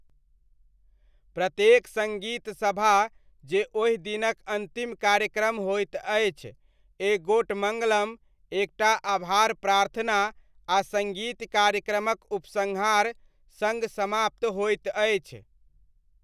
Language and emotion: Maithili, neutral